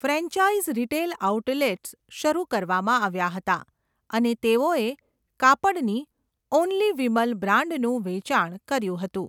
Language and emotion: Gujarati, neutral